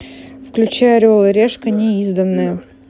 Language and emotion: Russian, neutral